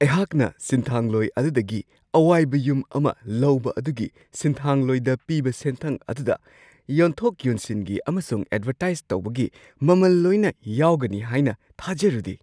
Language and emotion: Manipuri, surprised